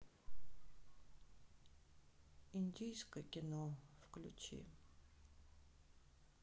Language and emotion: Russian, sad